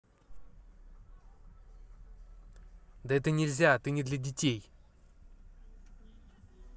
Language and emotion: Russian, angry